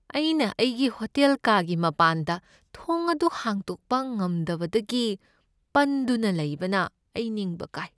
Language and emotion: Manipuri, sad